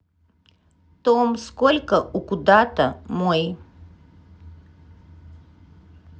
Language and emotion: Russian, neutral